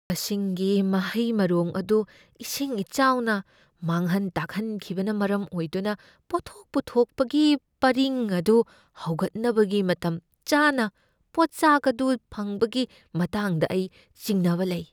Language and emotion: Manipuri, fearful